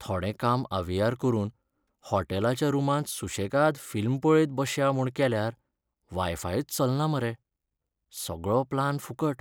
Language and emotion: Goan Konkani, sad